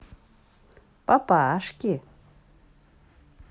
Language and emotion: Russian, positive